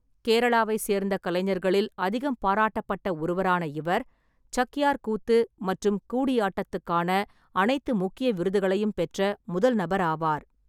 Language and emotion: Tamil, neutral